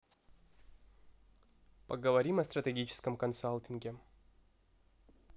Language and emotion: Russian, neutral